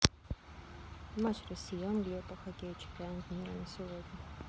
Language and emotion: Russian, neutral